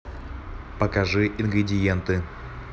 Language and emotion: Russian, neutral